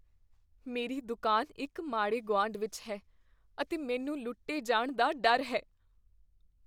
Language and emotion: Punjabi, fearful